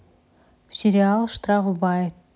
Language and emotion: Russian, neutral